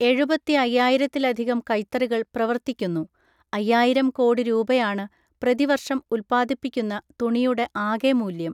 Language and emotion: Malayalam, neutral